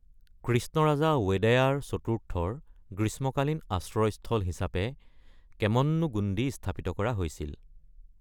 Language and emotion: Assamese, neutral